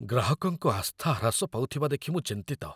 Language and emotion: Odia, fearful